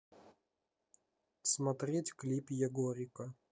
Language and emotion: Russian, neutral